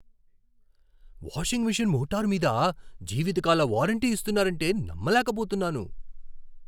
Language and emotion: Telugu, surprised